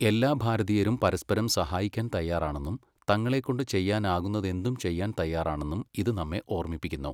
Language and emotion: Malayalam, neutral